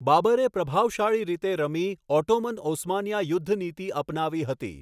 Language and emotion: Gujarati, neutral